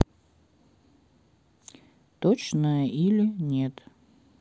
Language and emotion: Russian, neutral